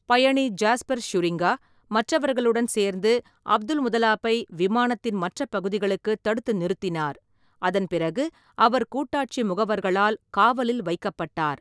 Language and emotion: Tamil, neutral